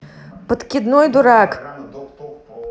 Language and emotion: Russian, angry